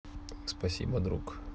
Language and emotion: Russian, neutral